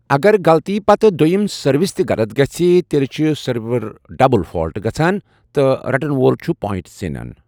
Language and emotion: Kashmiri, neutral